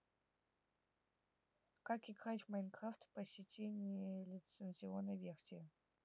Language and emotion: Russian, neutral